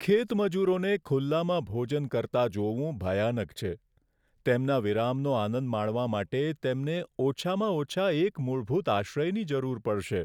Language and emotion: Gujarati, sad